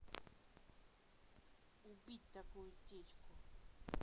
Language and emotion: Russian, neutral